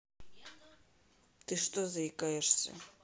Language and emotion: Russian, neutral